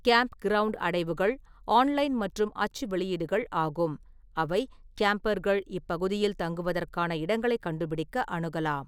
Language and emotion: Tamil, neutral